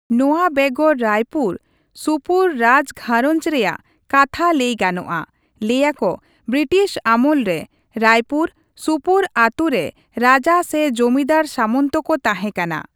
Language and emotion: Santali, neutral